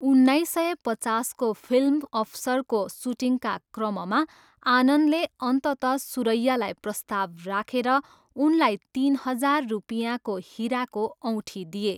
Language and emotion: Nepali, neutral